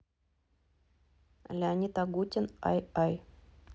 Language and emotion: Russian, neutral